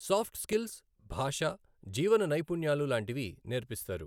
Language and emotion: Telugu, neutral